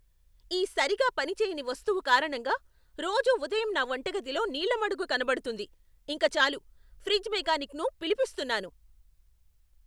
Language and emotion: Telugu, angry